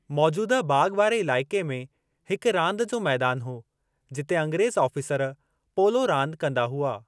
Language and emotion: Sindhi, neutral